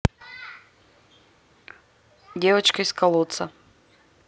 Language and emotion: Russian, neutral